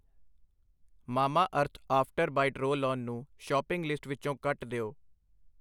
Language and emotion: Punjabi, neutral